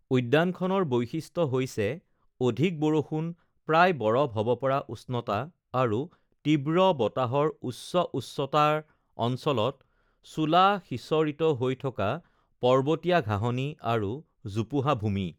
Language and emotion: Assamese, neutral